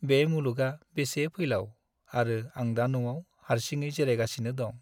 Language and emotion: Bodo, sad